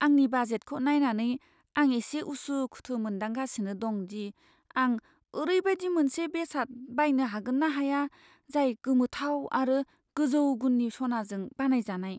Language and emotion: Bodo, fearful